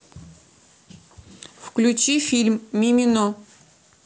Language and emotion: Russian, neutral